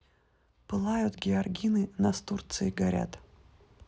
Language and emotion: Russian, neutral